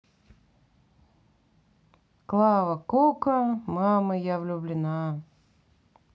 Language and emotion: Russian, sad